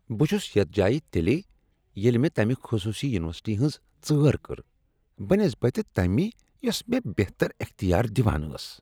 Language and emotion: Kashmiri, disgusted